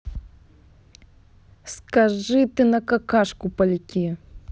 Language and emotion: Russian, angry